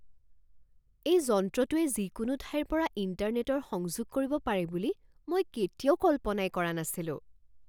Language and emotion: Assamese, surprised